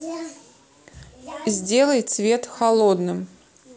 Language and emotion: Russian, neutral